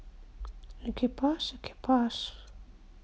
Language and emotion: Russian, neutral